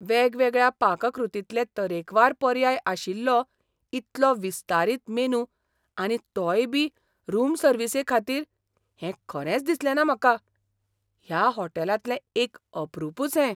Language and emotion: Goan Konkani, surprised